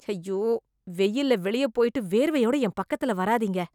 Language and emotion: Tamil, disgusted